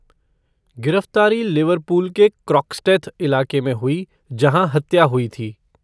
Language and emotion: Hindi, neutral